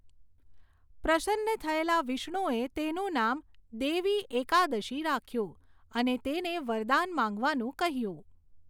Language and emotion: Gujarati, neutral